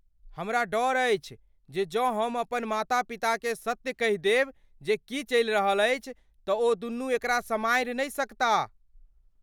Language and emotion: Maithili, fearful